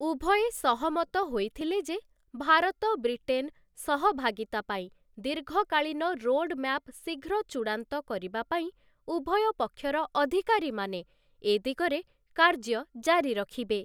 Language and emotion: Odia, neutral